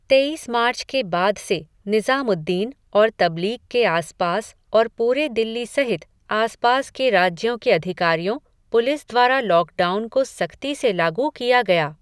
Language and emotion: Hindi, neutral